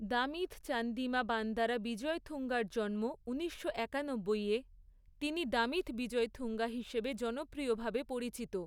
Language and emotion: Bengali, neutral